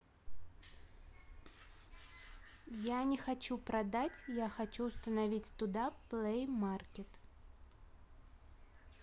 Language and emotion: Russian, neutral